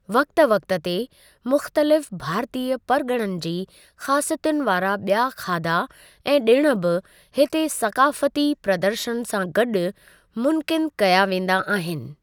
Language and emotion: Sindhi, neutral